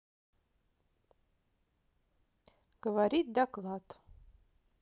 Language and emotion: Russian, positive